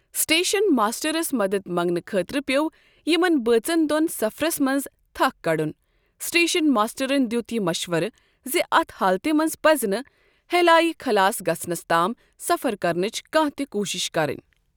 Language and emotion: Kashmiri, neutral